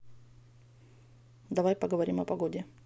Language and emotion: Russian, neutral